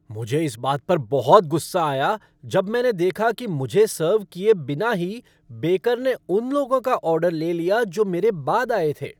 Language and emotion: Hindi, angry